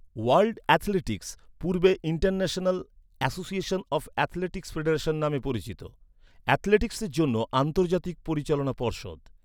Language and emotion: Bengali, neutral